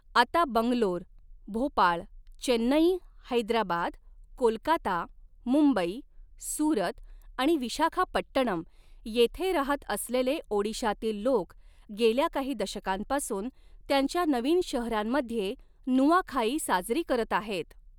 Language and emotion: Marathi, neutral